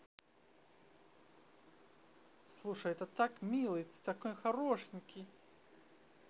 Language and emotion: Russian, positive